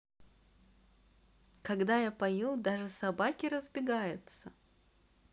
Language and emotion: Russian, positive